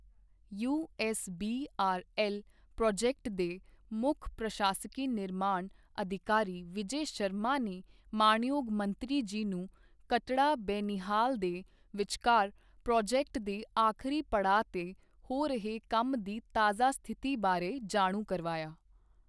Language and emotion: Punjabi, neutral